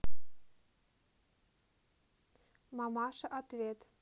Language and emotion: Russian, neutral